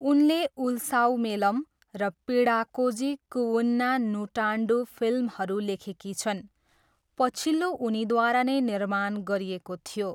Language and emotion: Nepali, neutral